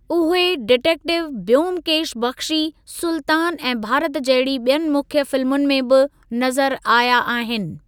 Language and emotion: Sindhi, neutral